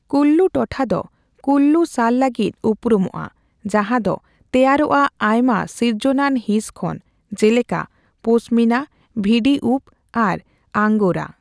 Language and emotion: Santali, neutral